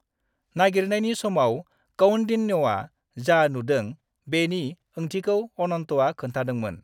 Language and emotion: Bodo, neutral